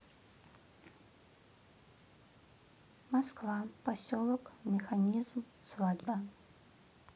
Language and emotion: Russian, neutral